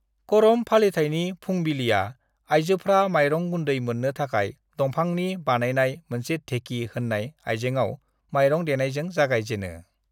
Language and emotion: Bodo, neutral